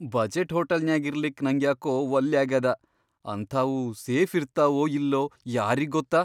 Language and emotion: Kannada, fearful